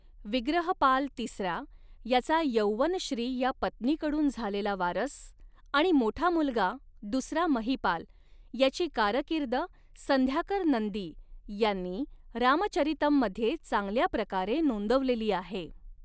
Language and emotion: Marathi, neutral